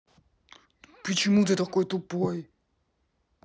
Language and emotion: Russian, angry